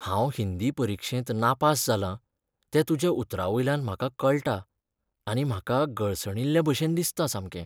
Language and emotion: Goan Konkani, sad